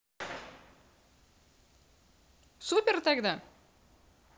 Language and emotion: Russian, positive